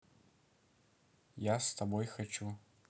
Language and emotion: Russian, neutral